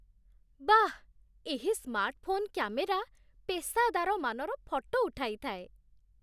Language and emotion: Odia, surprised